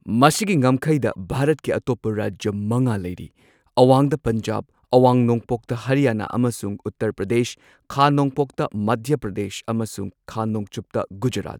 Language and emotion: Manipuri, neutral